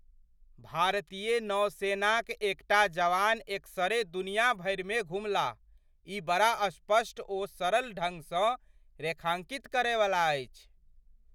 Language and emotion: Maithili, surprised